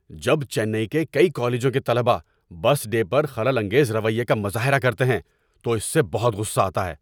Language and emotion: Urdu, angry